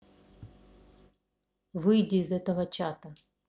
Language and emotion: Russian, neutral